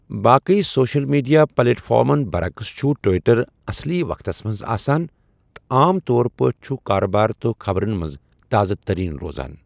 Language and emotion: Kashmiri, neutral